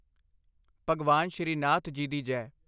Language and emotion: Punjabi, neutral